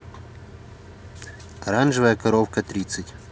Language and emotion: Russian, neutral